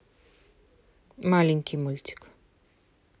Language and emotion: Russian, neutral